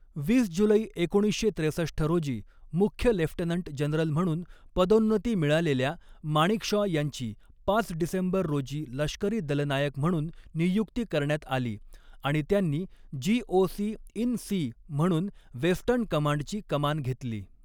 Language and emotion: Marathi, neutral